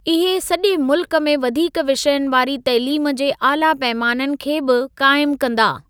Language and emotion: Sindhi, neutral